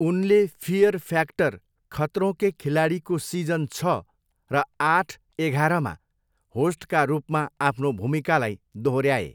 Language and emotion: Nepali, neutral